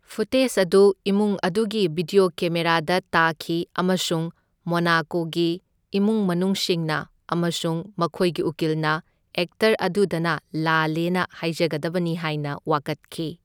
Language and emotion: Manipuri, neutral